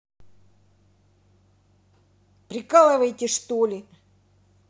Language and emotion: Russian, angry